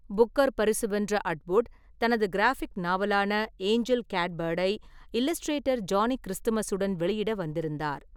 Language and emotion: Tamil, neutral